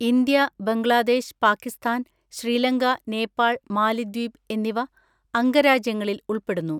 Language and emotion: Malayalam, neutral